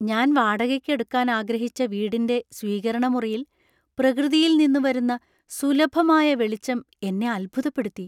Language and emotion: Malayalam, surprised